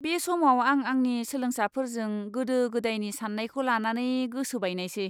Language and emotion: Bodo, disgusted